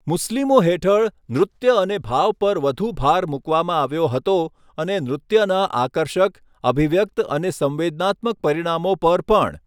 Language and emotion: Gujarati, neutral